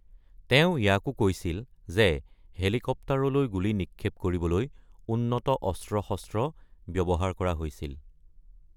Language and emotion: Assamese, neutral